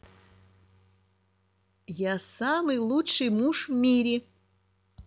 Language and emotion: Russian, neutral